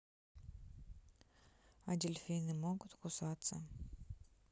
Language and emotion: Russian, neutral